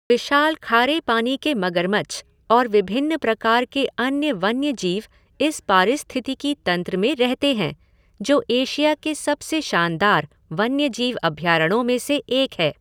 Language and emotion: Hindi, neutral